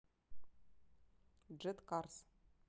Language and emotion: Russian, neutral